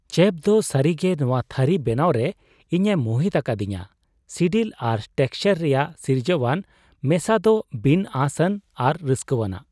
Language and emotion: Santali, surprised